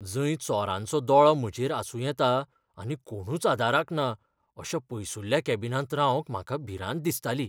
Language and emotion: Goan Konkani, fearful